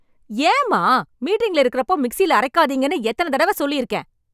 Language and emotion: Tamil, angry